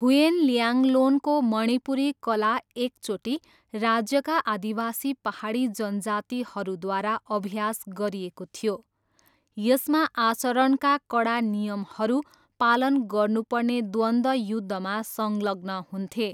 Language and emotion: Nepali, neutral